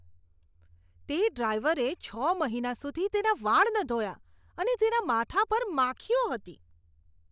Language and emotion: Gujarati, disgusted